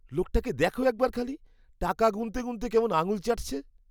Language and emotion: Bengali, disgusted